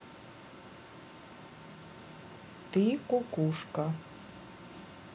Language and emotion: Russian, neutral